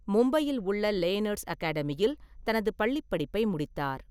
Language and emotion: Tamil, neutral